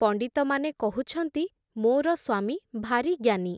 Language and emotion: Odia, neutral